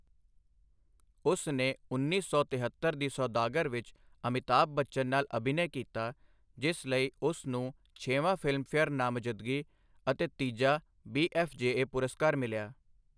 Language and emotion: Punjabi, neutral